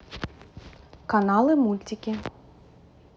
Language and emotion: Russian, neutral